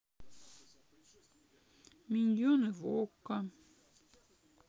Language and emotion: Russian, sad